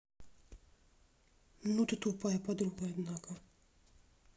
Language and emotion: Russian, angry